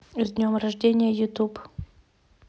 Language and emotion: Russian, neutral